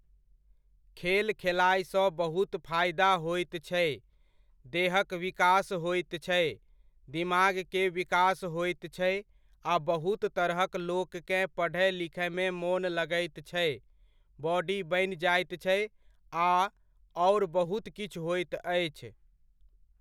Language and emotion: Maithili, neutral